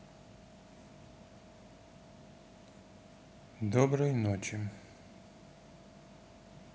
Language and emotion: Russian, neutral